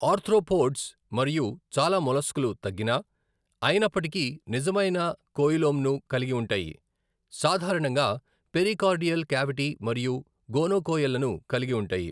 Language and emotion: Telugu, neutral